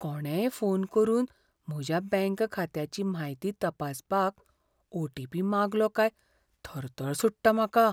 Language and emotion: Goan Konkani, fearful